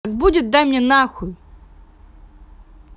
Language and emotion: Russian, angry